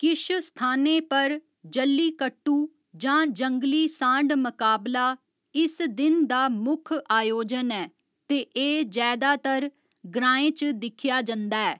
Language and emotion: Dogri, neutral